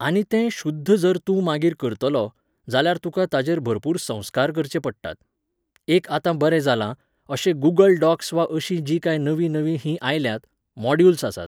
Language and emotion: Goan Konkani, neutral